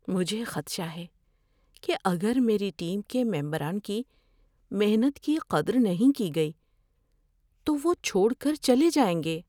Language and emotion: Urdu, fearful